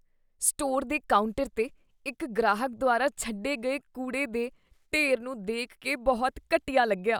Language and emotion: Punjabi, disgusted